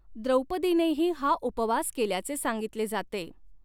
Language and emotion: Marathi, neutral